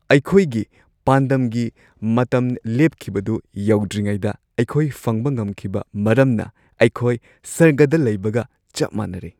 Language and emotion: Manipuri, happy